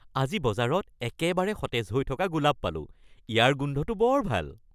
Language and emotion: Assamese, happy